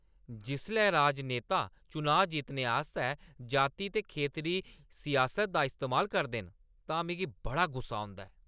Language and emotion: Dogri, angry